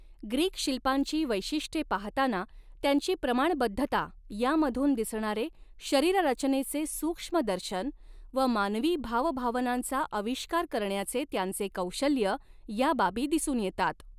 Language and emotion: Marathi, neutral